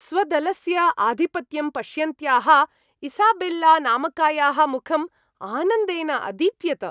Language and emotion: Sanskrit, happy